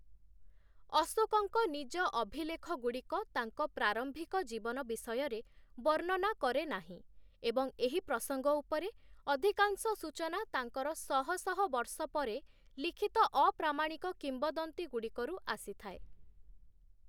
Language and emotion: Odia, neutral